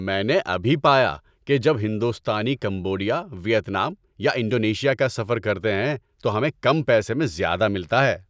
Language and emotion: Urdu, happy